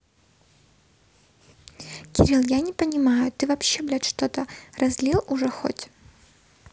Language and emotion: Russian, neutral